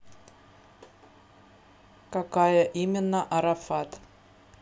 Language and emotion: Russian, neutral